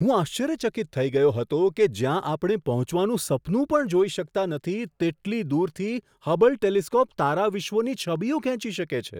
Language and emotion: Gujarati, surprised